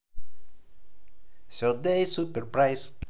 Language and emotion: Russian, positive